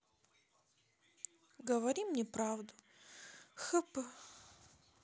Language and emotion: Russian, sad